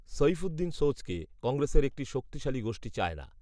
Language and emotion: Bengali, neutral